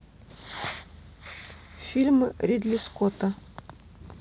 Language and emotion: Russian, neutral